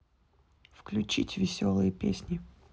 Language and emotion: Russian, neutral